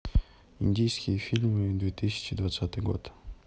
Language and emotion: Russian, neutral